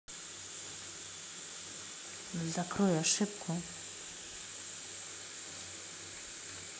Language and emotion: Russian, neutral